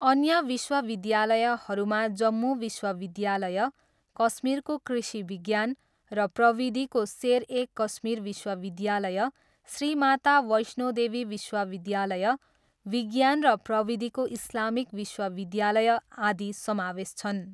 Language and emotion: Nepali, neutral